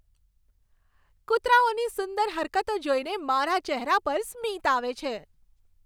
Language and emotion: Gujarati, happy